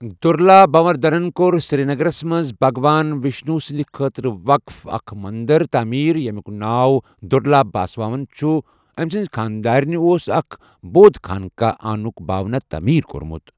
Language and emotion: Kashmiri, neutral